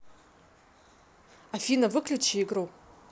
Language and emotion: Russian, angry